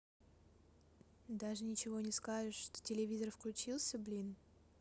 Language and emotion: Russian, neutral